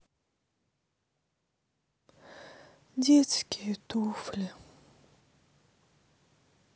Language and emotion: Russian, sad